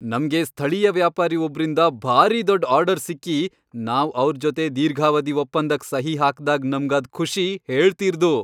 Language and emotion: Kannada, happy